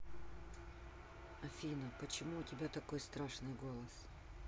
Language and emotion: Russian, neutral